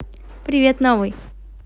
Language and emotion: Russian, positive